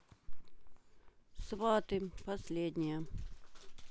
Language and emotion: Russian, neutral